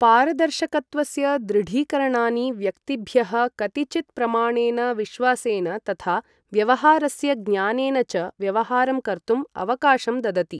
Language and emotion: Sanskrit, neutral